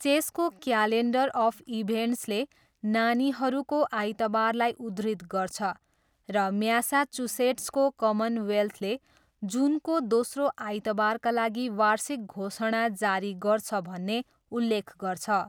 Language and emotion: Nepali, neutral